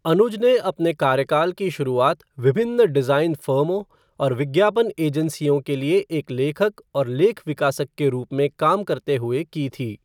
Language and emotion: Hindi, neutral